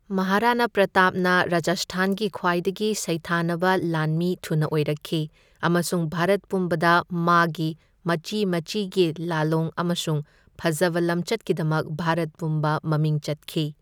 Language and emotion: Manipuri, neutral